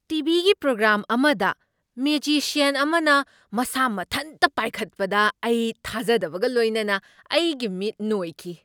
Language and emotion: Manipuri, surprised